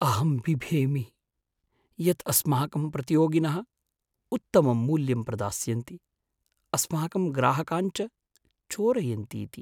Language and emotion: Sanskrit, fearful